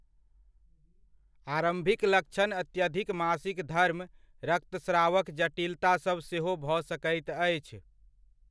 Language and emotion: Maithili, neutral